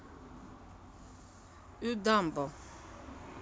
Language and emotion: Russian, neutral